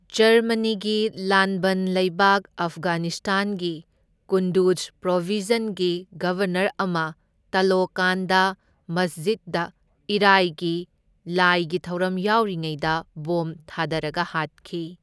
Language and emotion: Manipuri, neutral